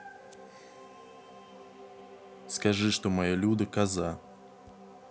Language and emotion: Russian, neutral